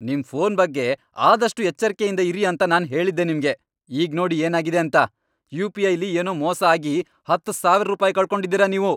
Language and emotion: Kannada, angry